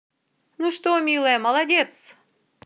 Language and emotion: Russian, positive